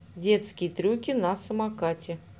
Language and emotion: Russian, neutral